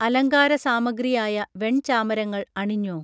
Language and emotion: Malayalam, neutral